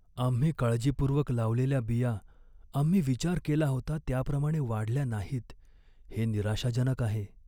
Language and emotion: Marathi, sad